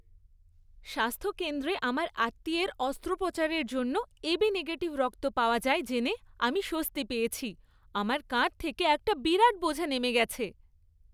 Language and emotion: Bengali, happy